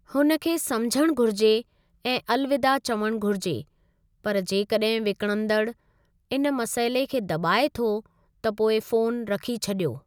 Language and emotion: Sindhi, neutral